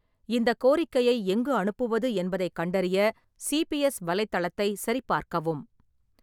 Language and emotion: Tamil, neutral